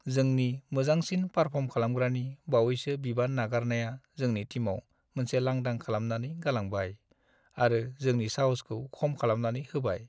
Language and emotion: Bodo, sad